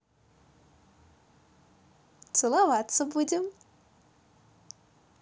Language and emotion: Russian, positive